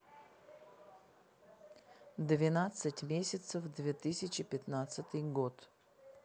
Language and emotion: Russian, neutral